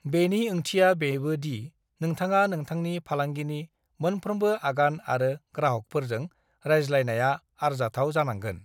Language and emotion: Bodo, neutral